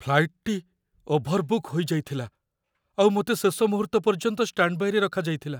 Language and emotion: Odia, fearful